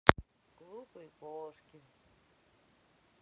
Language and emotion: Russian, sad